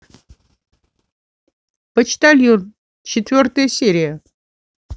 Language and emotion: Russian, neutral